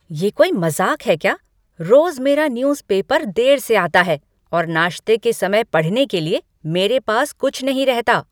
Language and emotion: Hindi, angry